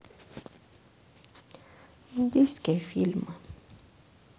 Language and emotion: Russian, sad